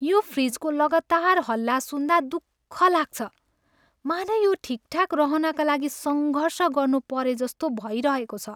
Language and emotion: Nepali, sad